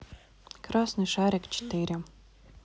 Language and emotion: Russian, neutral